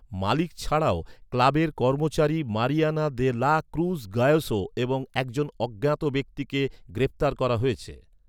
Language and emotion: Bengali, neutral